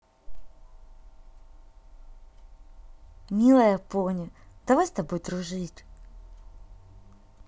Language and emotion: Russian, positive